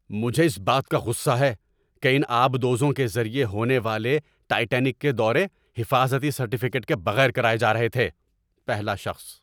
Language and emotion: Urdu, angry